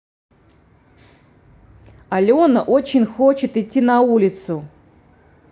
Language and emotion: Russian, neutral